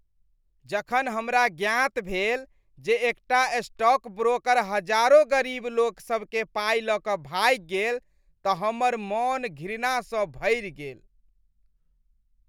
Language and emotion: Maithili, disgusted